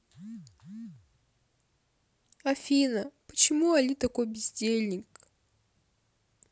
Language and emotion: Russian, sad